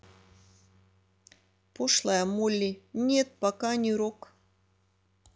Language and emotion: Russian, neutral